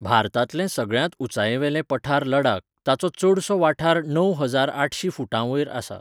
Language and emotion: Goan Konkani, neutral